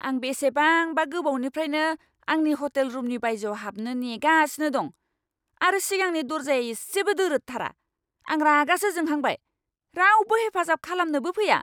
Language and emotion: Bodo, angry